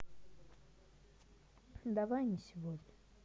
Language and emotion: Russian, sad